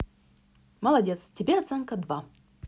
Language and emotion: Russian, neutral